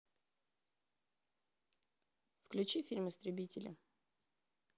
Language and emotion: Russian, neutral